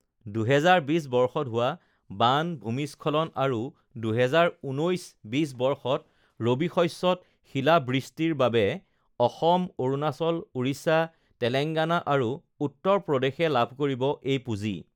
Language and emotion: Assamese, neutral